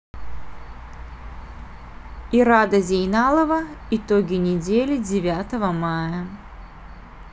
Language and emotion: Russian, neutral